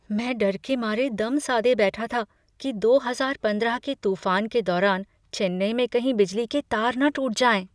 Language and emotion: Hindi, fearful